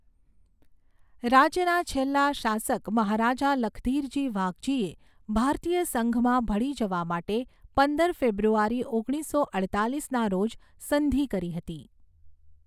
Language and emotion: Gujarati, neutral